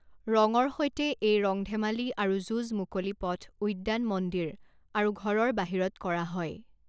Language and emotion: Assamese, neutral